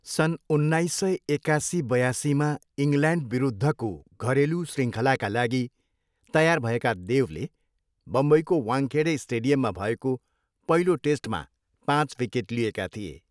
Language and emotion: Nepali, neutral